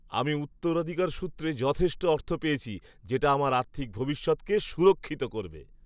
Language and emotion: Bengali, happy